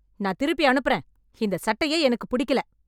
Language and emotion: Tamil, angry